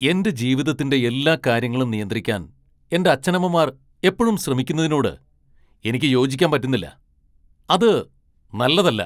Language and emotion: Malayalam, angry